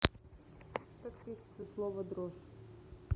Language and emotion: Russian, neutral